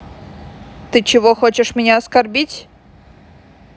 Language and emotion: Russian, angry